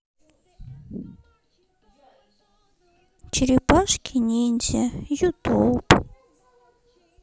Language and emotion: Russian, sad